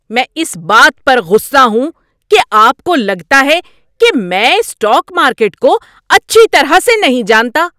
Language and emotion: Urdu, angry